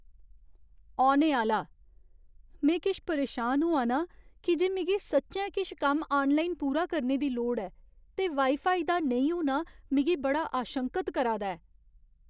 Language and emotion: Dogri, fearful